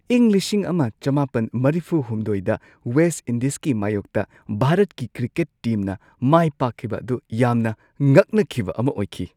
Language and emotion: Manipuri, surprised